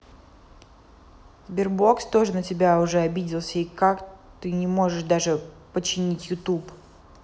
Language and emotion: Russian, angry